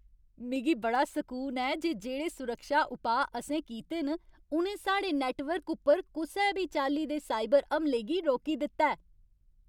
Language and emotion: Dogri, happy